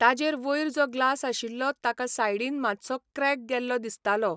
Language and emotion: Goan Konkani, neutral